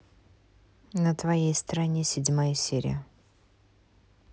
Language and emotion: Russian, neutral